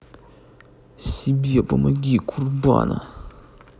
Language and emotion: Russian, angry